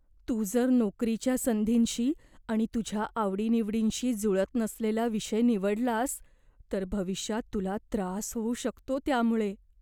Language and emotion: Marathi, fearful